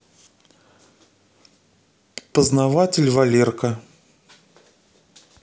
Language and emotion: Russian, neutral